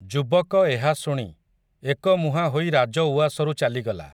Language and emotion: Odia, neutral